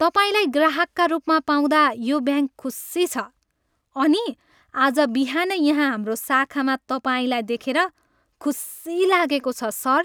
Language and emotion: Nepali, happy